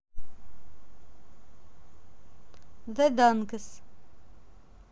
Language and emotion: Russian, neutral